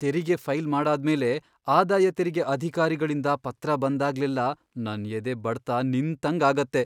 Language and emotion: Kannada, fearful